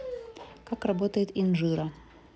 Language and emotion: Russian, neutral